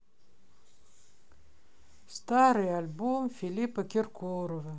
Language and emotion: Russian, sad